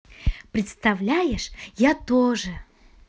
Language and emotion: Russian, positive